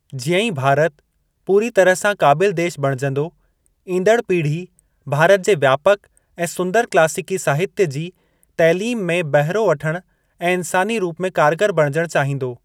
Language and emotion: Sindhi, neutral